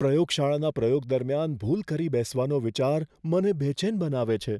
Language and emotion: Gujarati, fearful